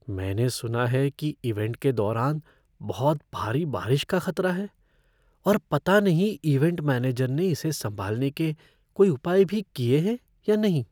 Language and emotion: Hindi, fearful